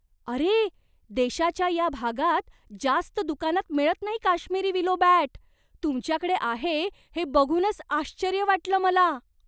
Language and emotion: Marathi, surprised